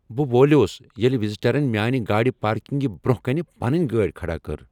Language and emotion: Kashmiri, angry